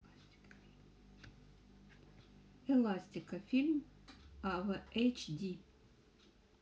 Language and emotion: Russian, neutral